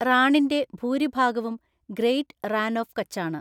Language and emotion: Malayalam, neutral